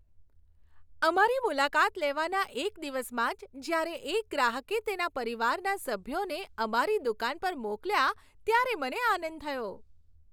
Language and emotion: Gujarati, happy